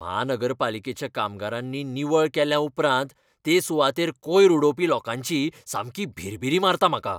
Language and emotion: Goan Konkani, angry